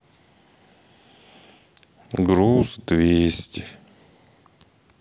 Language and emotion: Russian, sad